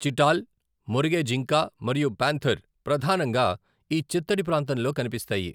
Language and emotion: Telugu, neutral